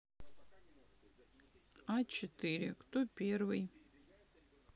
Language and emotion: Russian, sad